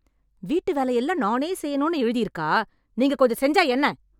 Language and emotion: Tamil, angry